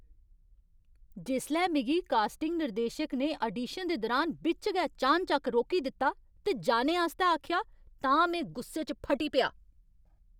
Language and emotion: Dogri, angry